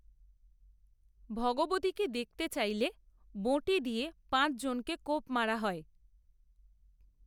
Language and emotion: Bengali, neutral